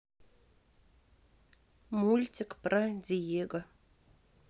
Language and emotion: Russian, neutral